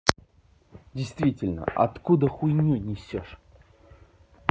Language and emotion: Russian, angry